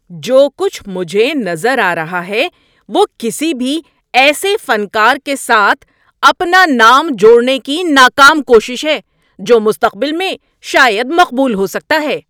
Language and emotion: Urdu, angry